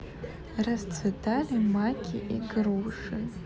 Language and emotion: Russian, neutral